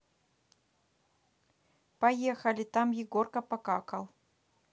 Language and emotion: Russian, neutral